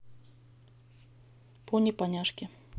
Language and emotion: Russian, neutral